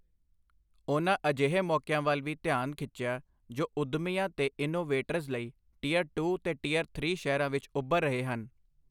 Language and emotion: Punjabi, neutral